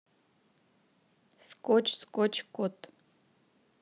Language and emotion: Russian, neutral